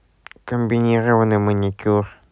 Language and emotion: Russian, neutral